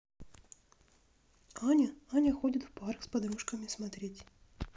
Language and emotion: Russian, neutral